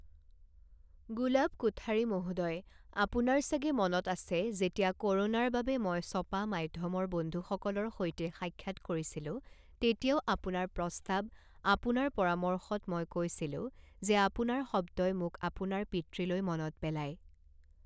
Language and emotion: Assamese, neutral